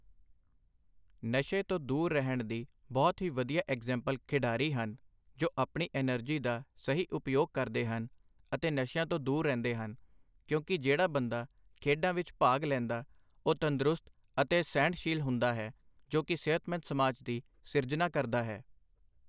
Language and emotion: Punjabi, neutral